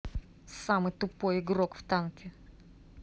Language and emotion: Russian, angry